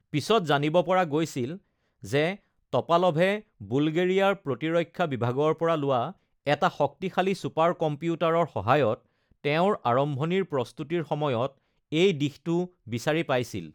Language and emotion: Assamese, neutral